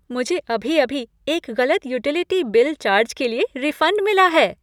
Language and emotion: Hindi, happy